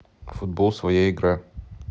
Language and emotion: Russian, neutral